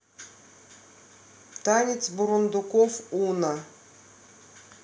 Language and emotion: Russian, neutral